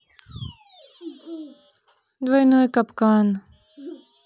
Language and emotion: Russian, neutral